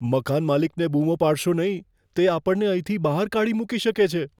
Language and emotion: Gujarati, fearful